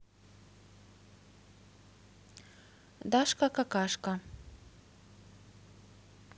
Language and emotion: Russian, neutral